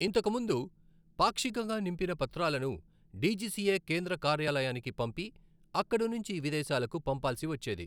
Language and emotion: Telugu, neutral